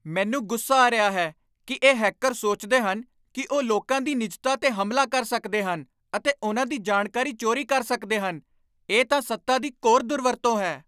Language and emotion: Punjabi, angry